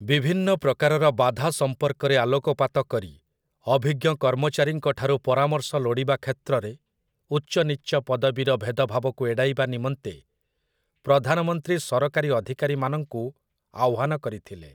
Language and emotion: Odia, neutral